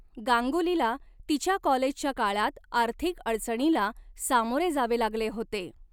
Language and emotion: Marathi, neutral